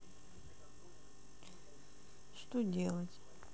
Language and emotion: Russian, sad